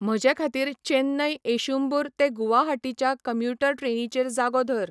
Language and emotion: Goan Konkani, neutral